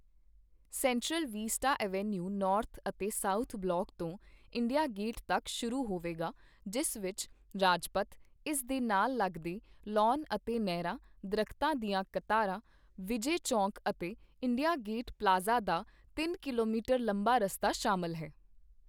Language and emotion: Punjabi, neutral